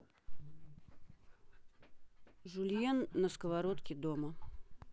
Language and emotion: Russian, neutral